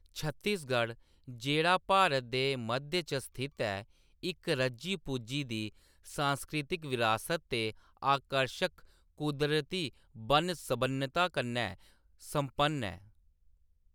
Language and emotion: Dogri, neutral